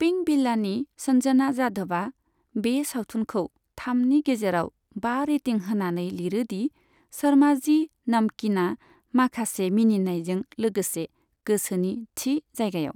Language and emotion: Bodo, neutral